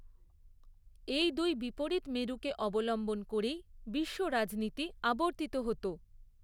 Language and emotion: Bengali, neutral